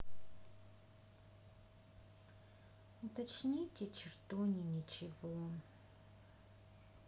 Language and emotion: Russian, neutral